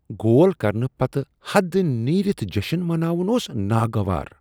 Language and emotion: Kashmiri, disgusted